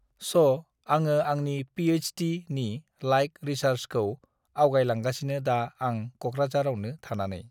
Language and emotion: Bodo, neutral